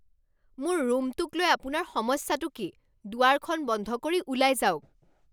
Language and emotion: Assamese, angry